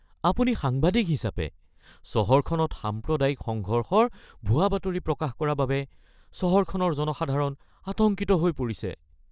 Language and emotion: Assamese, fearful